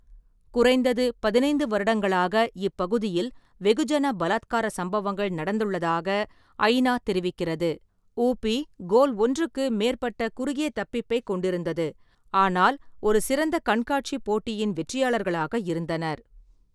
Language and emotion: Tamil, neutral